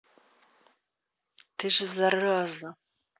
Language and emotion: Russian, angry